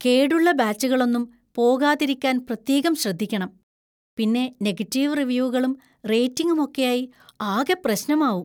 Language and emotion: Malayalam, fearful